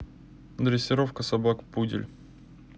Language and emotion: Russian, neutral